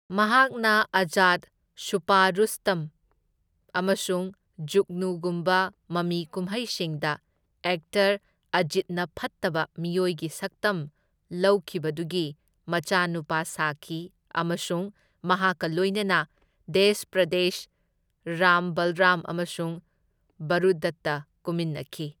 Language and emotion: Manipuri, neutral